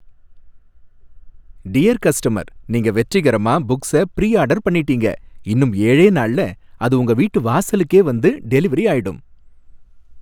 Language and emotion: Tamil, happy